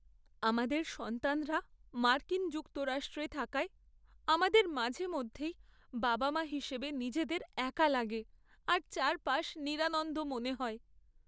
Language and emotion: Bengali, sad